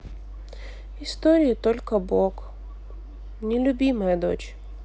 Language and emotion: Russian, sad